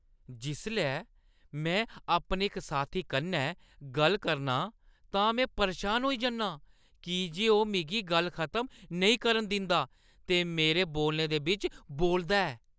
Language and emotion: Dogri, angry